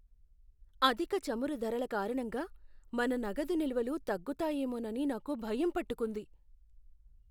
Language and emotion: Telugu, fearful